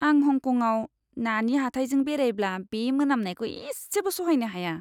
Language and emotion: Bodo, disgusted